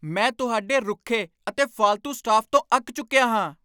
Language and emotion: Punjabi, angry